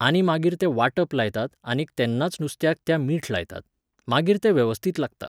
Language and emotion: Goan Konkani, neutral